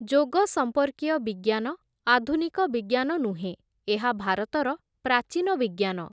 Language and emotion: Odia, neutral